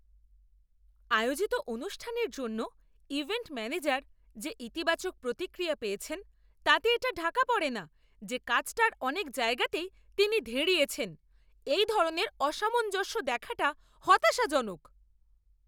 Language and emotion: Bengali, angry